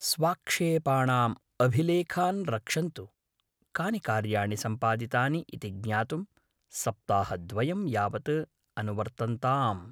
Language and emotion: Sanskrit, neutral